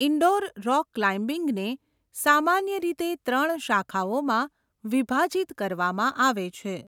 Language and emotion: Gujarati, neutral